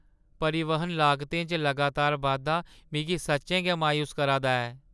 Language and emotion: Dogri, sad